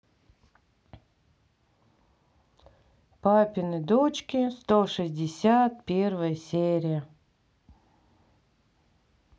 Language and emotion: Russian, neutral